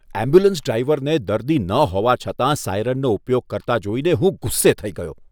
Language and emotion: Gujarati, disgusted